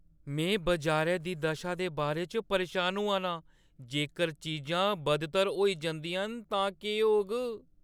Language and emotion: Dogri, fearful